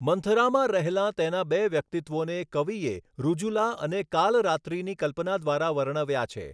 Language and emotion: Gujarati, neutral